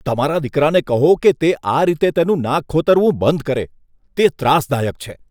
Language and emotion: Gujarati, disgusted